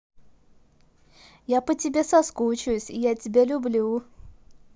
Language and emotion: Russian, positive